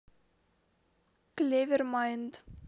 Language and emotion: Russian, neutral